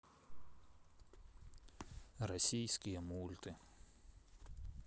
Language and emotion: Russian, neutral